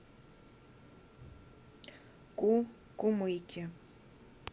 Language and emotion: Russian, neutral